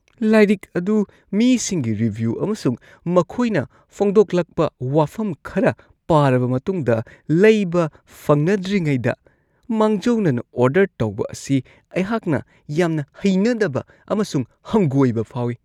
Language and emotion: Manipuri, disgusted